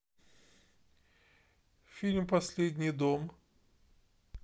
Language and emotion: Russian, neutral